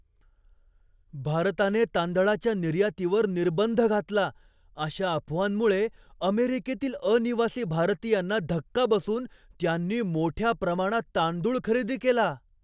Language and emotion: Marathi, surprised